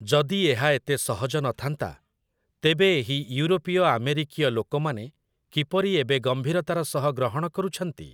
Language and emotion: Odia, neutral